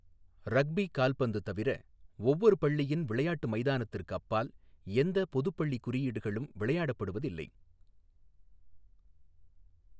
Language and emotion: Tamil, neutral